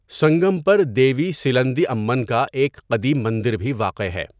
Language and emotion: Urdu, neutral